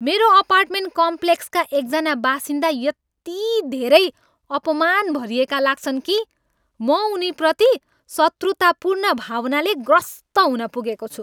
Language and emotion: Nepali, angry